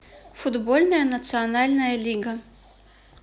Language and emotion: Russian, neutral